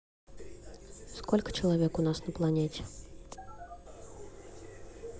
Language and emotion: Russian, neutral